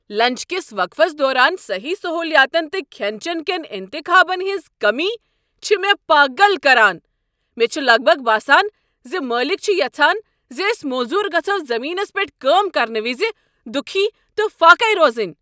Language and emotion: Kashmiri, angry